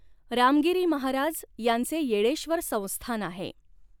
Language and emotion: Marathi, neutral